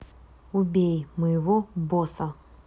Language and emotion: Russian, neutral